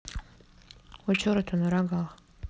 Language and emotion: Russian, neutral